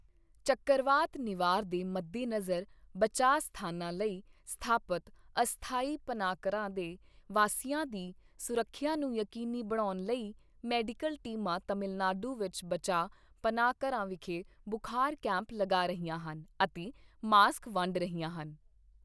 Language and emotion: Punjabi, neutral